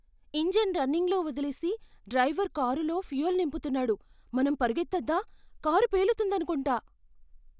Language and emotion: Telugu, fearful